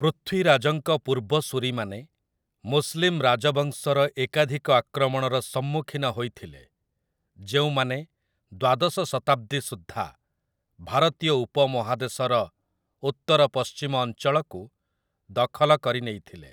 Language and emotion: Odia, neutral